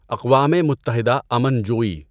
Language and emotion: Urdu, neutral